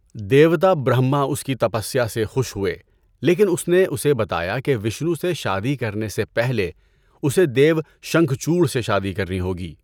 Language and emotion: Urdu, neutral